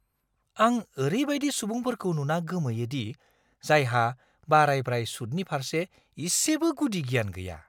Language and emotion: Bodo, surprised